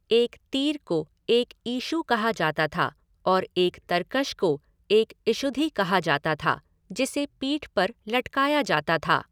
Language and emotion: Hindi, neutral